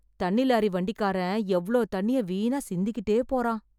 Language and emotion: Tamil, sad